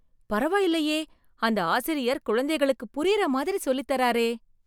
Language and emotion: Tamil, surprised